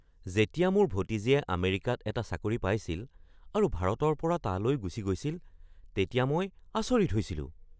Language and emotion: Assamese, surprised